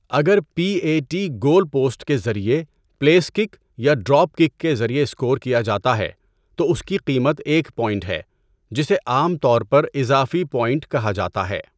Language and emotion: Urdu, neutral